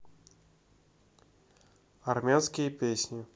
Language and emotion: Russian, neutral